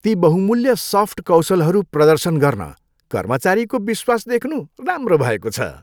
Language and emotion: Nepali, happy